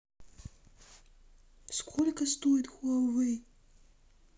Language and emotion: Russian, angry